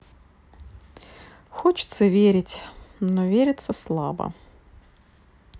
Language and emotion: Russian, sad